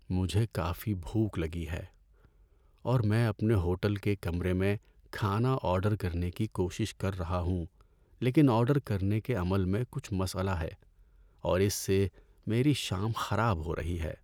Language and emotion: Urdu, sad